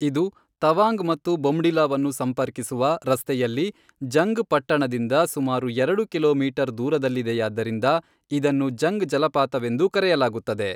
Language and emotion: Kannada, neutral